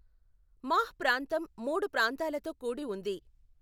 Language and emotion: Telugu, neutral